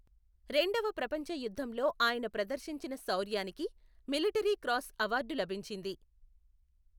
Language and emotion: Telugu, neutral